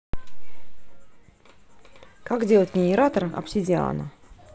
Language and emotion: Russian, neutral